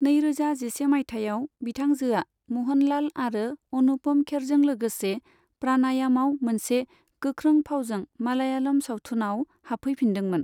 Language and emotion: Bodo, neutral